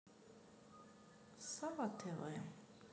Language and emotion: Russian, neutral